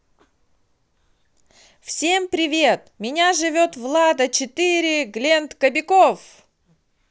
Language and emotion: Russian, positive